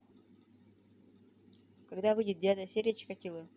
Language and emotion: Russian, neutral